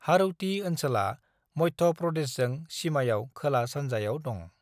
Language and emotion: Bodo, neutral